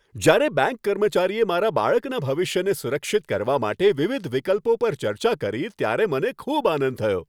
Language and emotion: Gujarati, happy